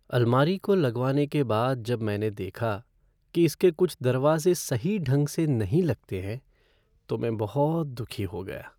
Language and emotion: Hindi, sad